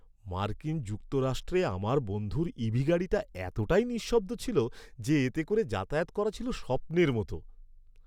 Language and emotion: Bengali, happy